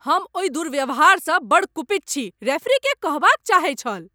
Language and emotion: Maithili, angry